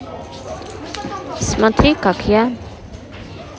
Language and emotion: Russian, neutral